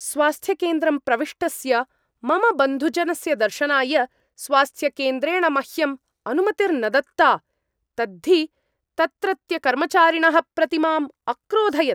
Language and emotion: Sanskrit, angry